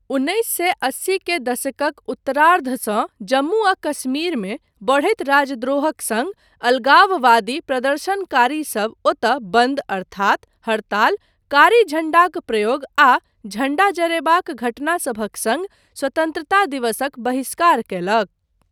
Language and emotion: Maithili, neutral